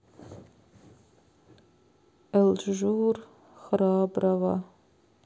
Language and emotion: Russian, sad